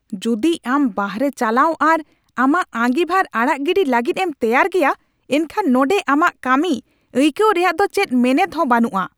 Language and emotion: Santali, angry